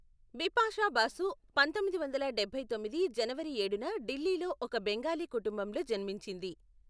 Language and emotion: Telugu, neutral